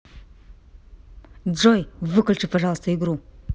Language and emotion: Russian, angry